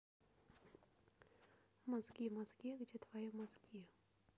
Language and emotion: Russian, neutral